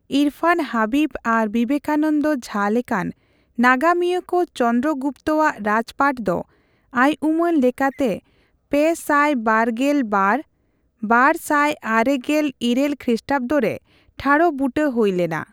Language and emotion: Santali, neutral